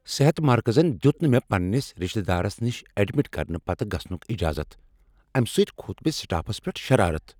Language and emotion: Kashmiri, angry